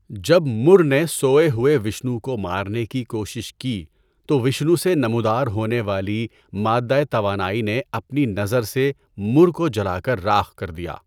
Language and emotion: Urdu, neutral